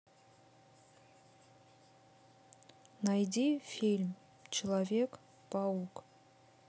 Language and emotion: Russian, neutral